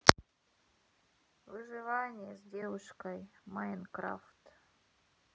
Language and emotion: Russian, sad